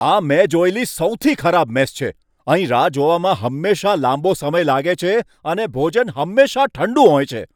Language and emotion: Gujarati, angry